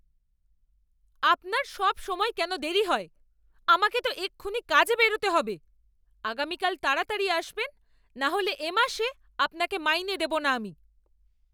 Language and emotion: Bengali, angry